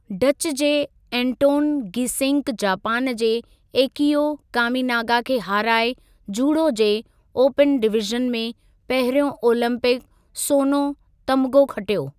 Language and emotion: Sindhi, neutral